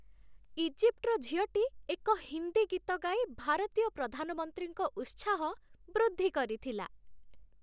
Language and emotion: Odia, happy